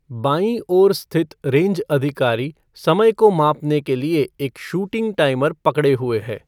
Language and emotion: Hindi, neutral